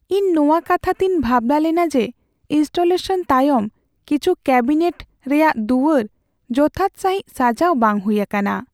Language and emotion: Santali, sad